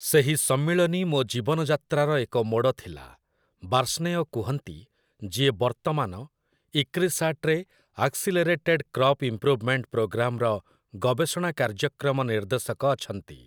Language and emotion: Odia, neutral